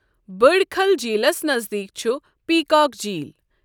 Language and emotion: Kashmiri, neutral